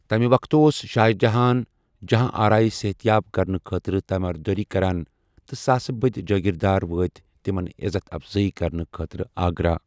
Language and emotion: Kashmiri, neutral